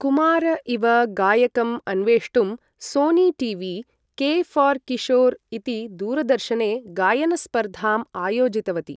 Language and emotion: Sanskrit, neutral